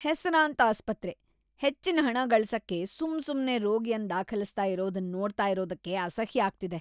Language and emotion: Kannada, disgusted